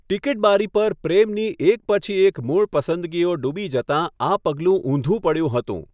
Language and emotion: Gujarati, neutral